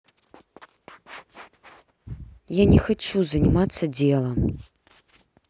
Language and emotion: Russian, angry